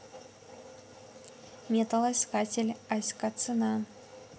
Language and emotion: Russian, neutral